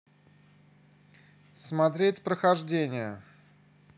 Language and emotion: Russian, neutral